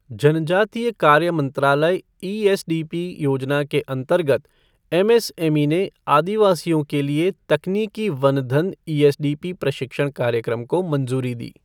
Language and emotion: Hindi, neutral